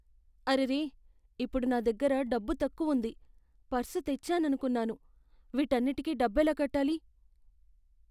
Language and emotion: Telugu, fearful